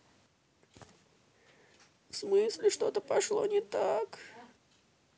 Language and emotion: Russian, sad